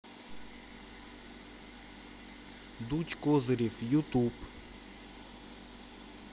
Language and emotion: Russian, neutral